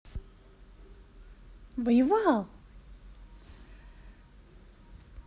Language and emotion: Russian, positive